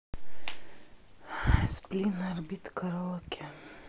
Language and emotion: Russian, sad